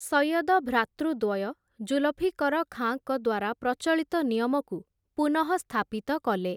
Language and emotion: Odia, neutral